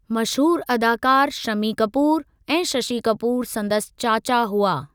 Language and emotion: Sindhi, neutral